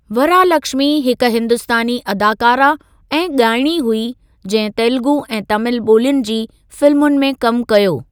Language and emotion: Sindhi, neutral